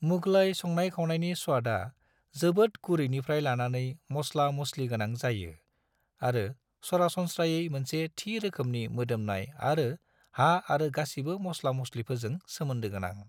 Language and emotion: Bodo, neutral